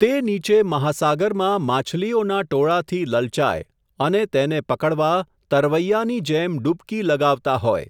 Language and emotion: Gujarati, neutral